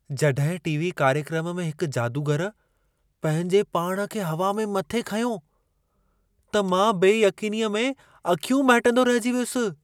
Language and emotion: Sindhi, surprised